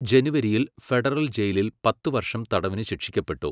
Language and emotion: Malayalam, neutral